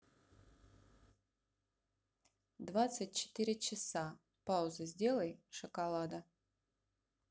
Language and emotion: Russian, neutral